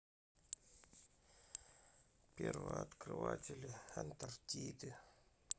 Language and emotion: Russian, sad